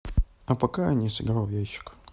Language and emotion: Russian, neutral